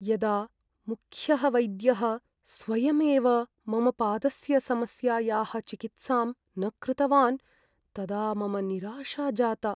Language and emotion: Sanskrit, sad